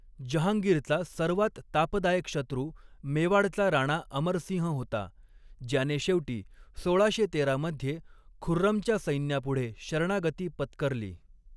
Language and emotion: Marathi, neutral